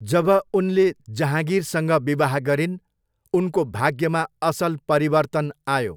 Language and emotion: Nepali, neutral